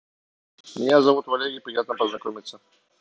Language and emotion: Russian, neutral